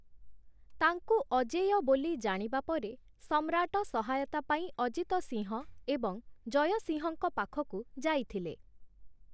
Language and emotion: Odia, neutral